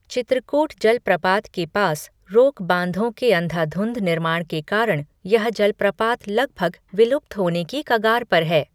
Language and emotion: Hindi, neutral